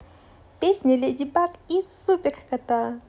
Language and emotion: Russian, positive